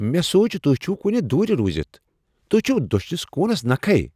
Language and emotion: Kashmiri, surprised